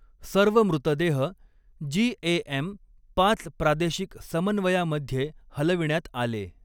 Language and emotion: Marathi, neutral